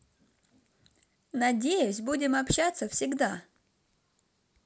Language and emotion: Russian, positive